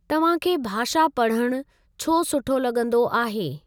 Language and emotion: Sindhi, neutral